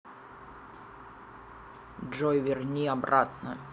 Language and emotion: Russian, angry